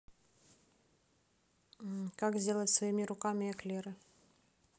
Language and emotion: Russian, neutral